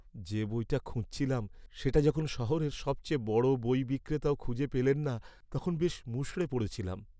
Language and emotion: Bengali, sad